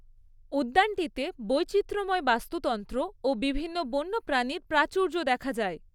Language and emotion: Bengali, neutral